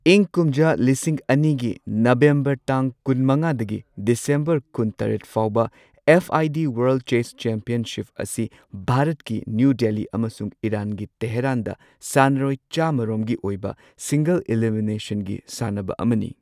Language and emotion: Manipuri, neutral